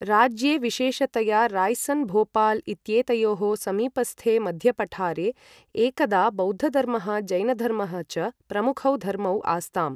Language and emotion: Sanskrit, neutral